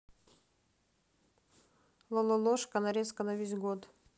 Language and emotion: Russian, neutral